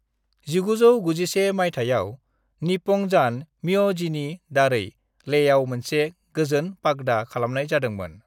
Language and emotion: Bodo, neutral